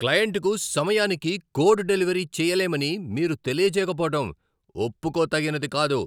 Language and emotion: Telugu, angry